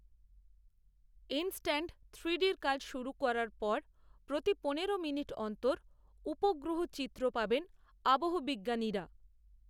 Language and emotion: Bengali, neutral